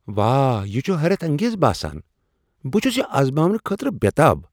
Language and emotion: Kashmiri, surprised